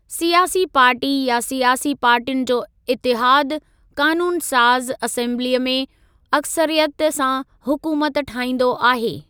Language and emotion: Sindhi, neutral